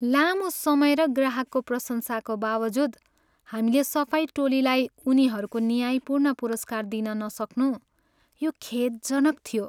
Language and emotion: Nepali, sad